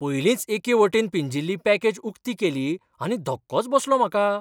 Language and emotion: Goan Konkani, surprised